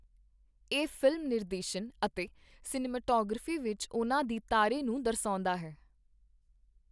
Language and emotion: Punjabi, neutral